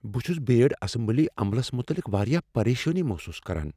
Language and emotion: Kashmiri, fearful